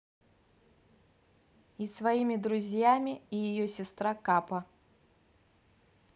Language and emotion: Russian, neutral